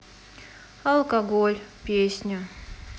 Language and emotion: Russian, sad